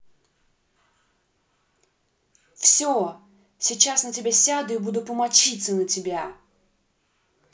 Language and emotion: Russian, angry